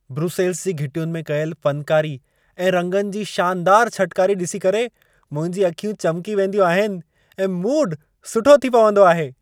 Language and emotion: Sindhi, happy